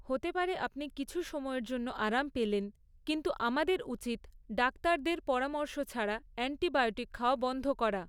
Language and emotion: Bengali, neutral